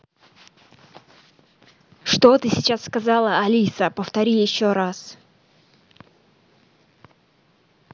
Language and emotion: Russian, angry